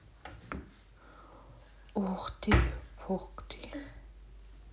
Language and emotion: Russian, neutral